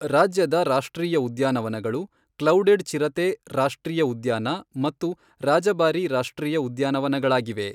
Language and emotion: Kannada, neutral